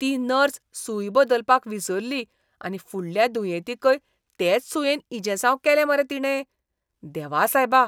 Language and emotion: Goan Konkani, disgusted